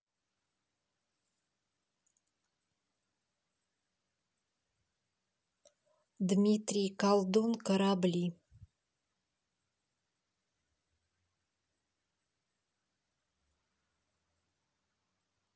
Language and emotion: Russian, neutral